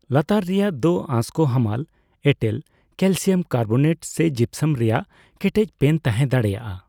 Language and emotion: Santali, neutral